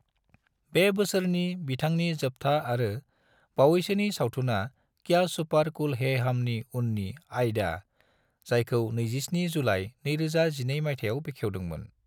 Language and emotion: Bodo, neutral